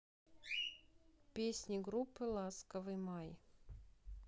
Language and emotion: Russian, neutral